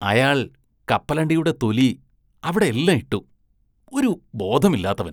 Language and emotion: Malayalam, disgusted